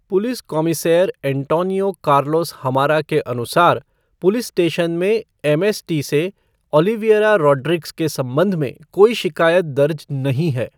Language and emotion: Hindi, neutral